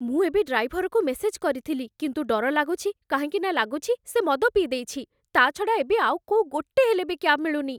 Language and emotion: Odia, fearful